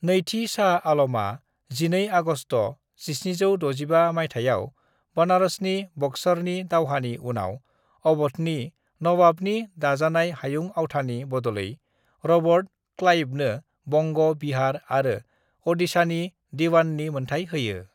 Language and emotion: Bodo, neutral